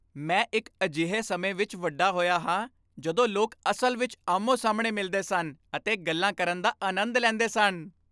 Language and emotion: Punjabi, happy